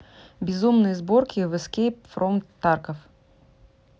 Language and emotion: Russian, neutral